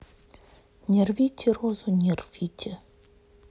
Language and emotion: Russian, neutral